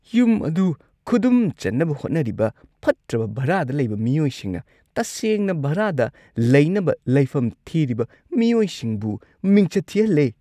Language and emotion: Manipuri, disgusted